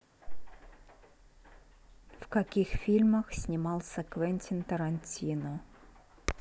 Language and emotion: Russian, neutral